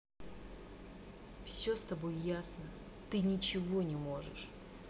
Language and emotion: Russian, angry